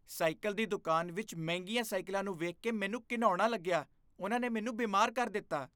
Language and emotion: Punjabi, disgusted